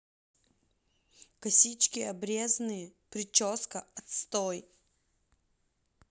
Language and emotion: Russian, angry